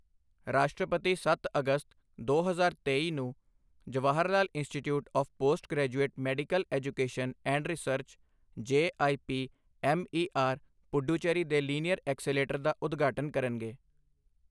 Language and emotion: Punjabi, neutral